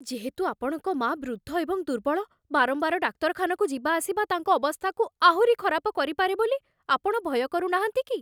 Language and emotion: Odia, fearful